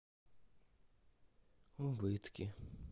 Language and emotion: Russian, sad